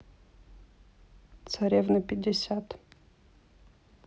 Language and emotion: Russian, neutral